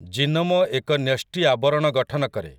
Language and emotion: Odia, neutral